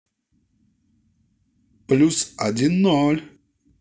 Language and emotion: Russian, positive